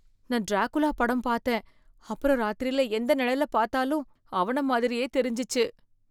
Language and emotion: Tamil, fearful